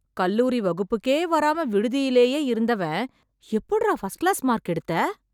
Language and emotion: Tamil, surprised